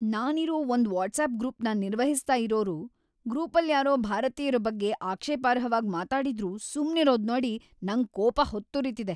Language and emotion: Kannada, angry